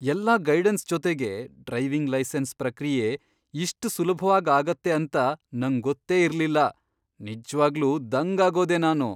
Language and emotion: Kannada, surprised